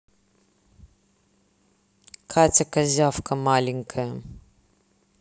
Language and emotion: Russian, neutral